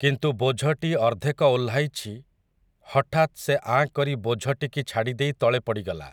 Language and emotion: Odia, neutral